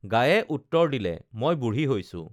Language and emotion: Assamese, neutral